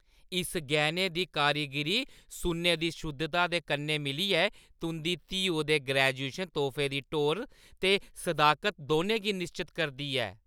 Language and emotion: Dogri, happy